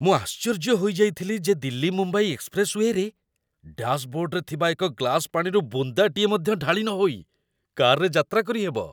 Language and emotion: Odia, surprised